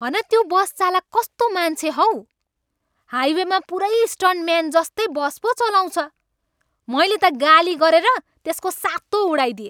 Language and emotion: Nepali, angry